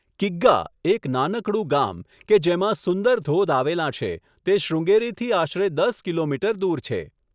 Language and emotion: Gujarati, neutral